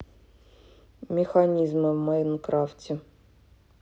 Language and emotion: Russian, neutral